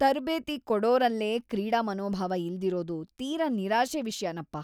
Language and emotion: Kannada, disgusted